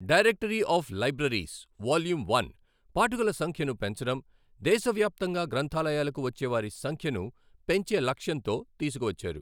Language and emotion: Telugu, neutral